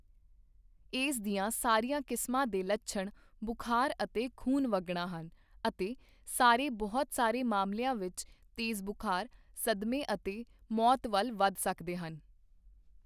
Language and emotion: Punjabi, neutral